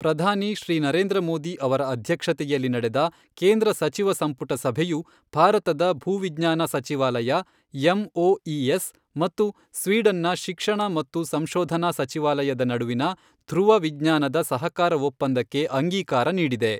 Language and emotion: Kannada, neutral